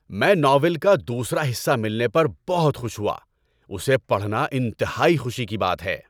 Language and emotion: Urdu, happy